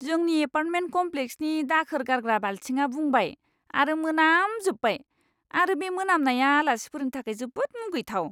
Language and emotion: Bodo, disgusted